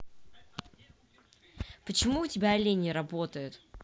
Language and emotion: Russian, angry